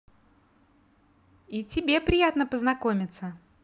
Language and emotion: Russian, positive